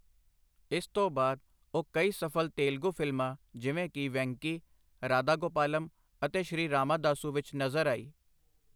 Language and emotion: Punjabi, neutral